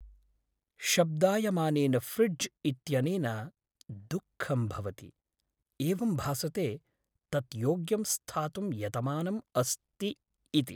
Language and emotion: Sanskrit, sad